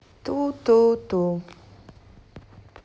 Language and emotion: Russian, neutral